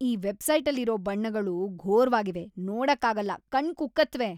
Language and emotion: Kannada, disgusted